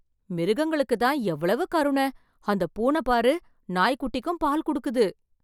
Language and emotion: Tamil, surprised